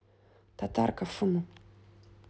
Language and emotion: Russian, neutral